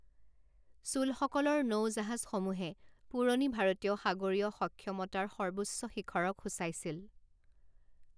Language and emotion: Assamese, neutral